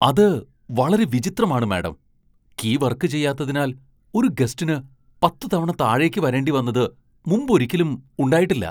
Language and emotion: Malayalam, surprised